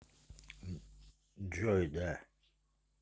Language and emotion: Russian, neutral